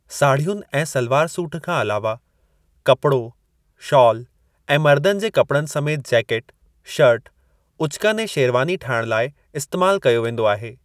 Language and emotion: Sindhi, neutral